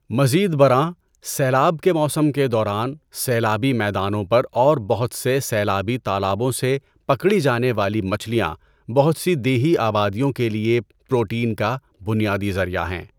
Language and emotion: Urdu, neutral